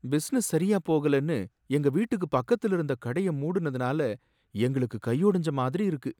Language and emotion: Tamil, sad